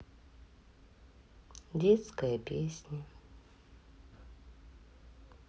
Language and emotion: Russian, sad